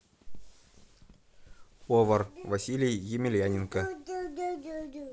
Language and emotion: Russian, neutral